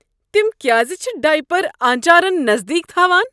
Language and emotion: Kashmiri, disgusted